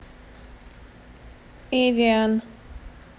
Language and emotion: Russian, neutral